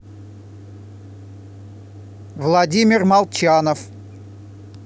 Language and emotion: Russian, neutral